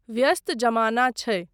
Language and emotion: Maithili, neutral